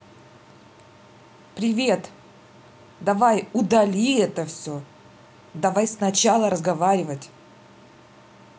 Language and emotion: Russian, neutral